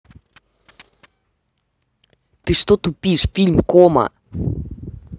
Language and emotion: Russian, angry